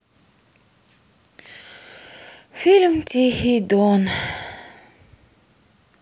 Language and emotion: Russian, sad